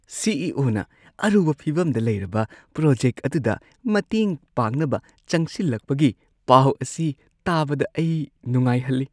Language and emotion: Manipuri, happy